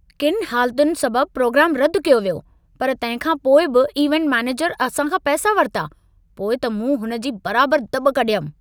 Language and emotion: Sindhi, angry